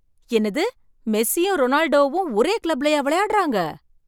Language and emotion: Tamil, surprised